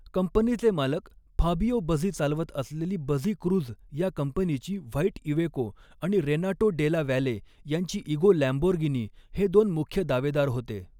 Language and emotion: Marathi, neutral